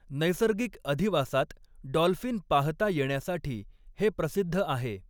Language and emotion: Marathi, neutral